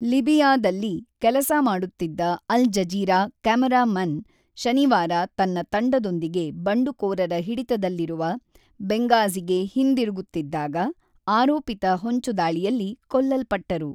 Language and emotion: Kannada, neutral